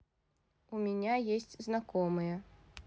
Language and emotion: Russian, neutral